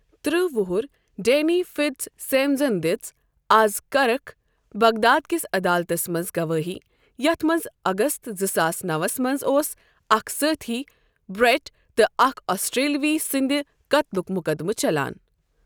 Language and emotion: Kashmiri, neutral